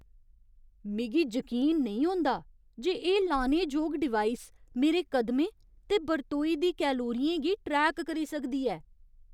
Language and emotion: Dogri, surprised